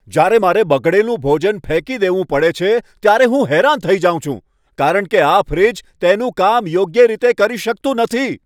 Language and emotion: Gujarati, angry